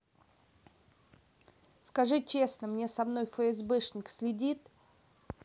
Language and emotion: Russian, angry